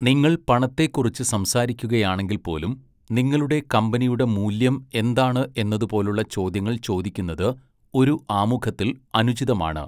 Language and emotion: Malayalam, neutral